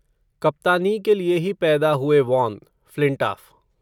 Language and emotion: Hindi, neutral